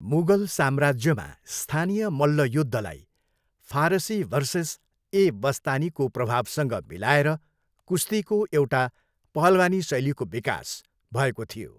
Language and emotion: Nepali, neutral